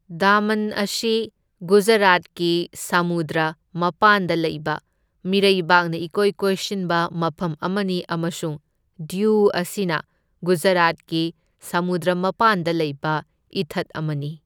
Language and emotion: Manipuri, neutral